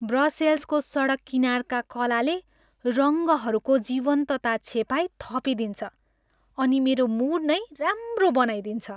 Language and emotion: Nepali, happy